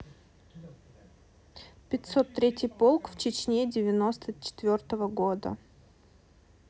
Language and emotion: Russian, neutral